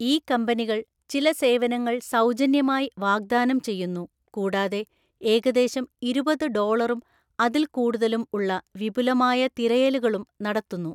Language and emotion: Malayalam, neutral